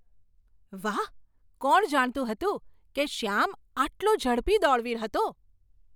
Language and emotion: Gujarati, surprised